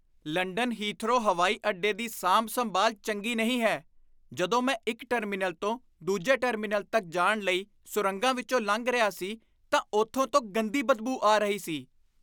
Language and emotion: Punjabi, disgusted